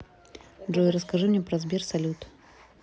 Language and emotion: Russian, neutral